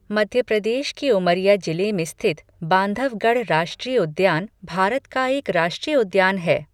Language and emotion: Hindi, neutral